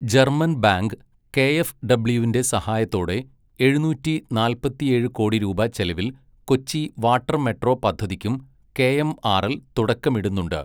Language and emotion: Malayalam, neutral